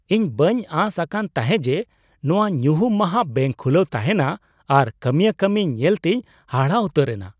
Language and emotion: Santali, surprised